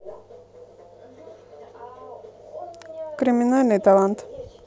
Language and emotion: Russian, neutral